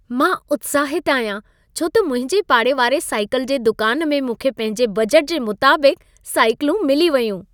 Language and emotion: Sindhi, happy